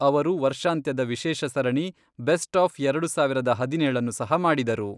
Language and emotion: Kannada, neutral